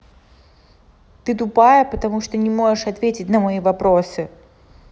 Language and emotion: Russian, angry